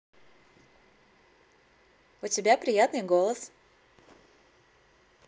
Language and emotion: Russian, positive